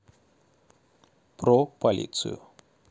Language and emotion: Russian, neutral